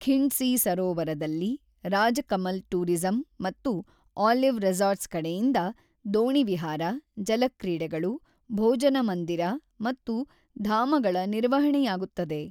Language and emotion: Kannada, neutral